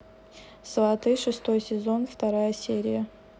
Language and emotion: Russian, neutral